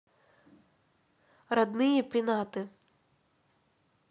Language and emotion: Russian, neutral